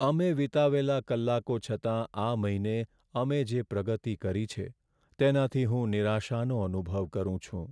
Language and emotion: Gujarati, sad